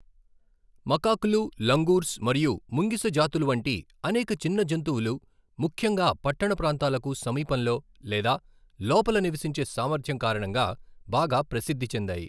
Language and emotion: Telugu, neutral